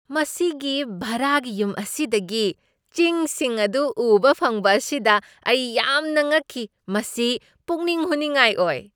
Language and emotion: Manipuri, surprised